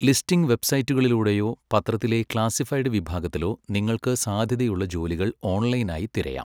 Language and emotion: Malayalam, neutral